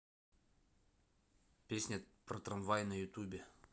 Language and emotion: Russian, neutral